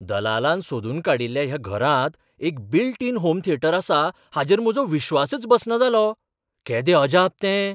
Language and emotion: Goan Konkani, surprised